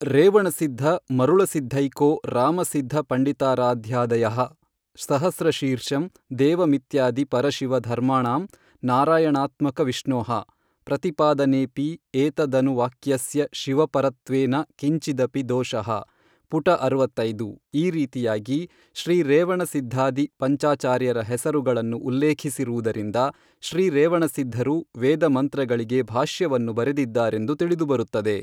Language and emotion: Kannada, neutral